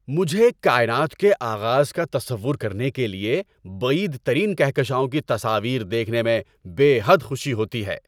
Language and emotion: Urdu, happy